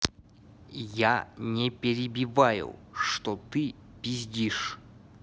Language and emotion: Russian, angry